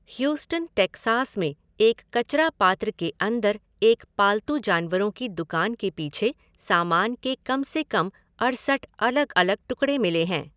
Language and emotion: Hindi, neutral